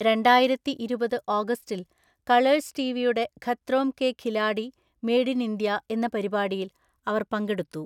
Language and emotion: Malayalam, neutral